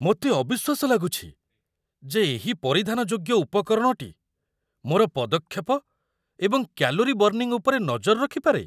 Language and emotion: Odia, surprised